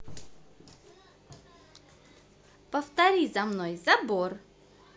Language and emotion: Russian, positive